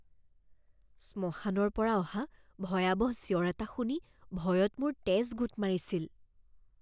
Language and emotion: Assamese, fearful